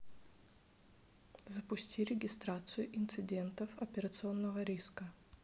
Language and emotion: Russian, neutral